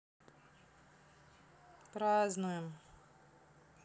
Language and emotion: Russian, neutral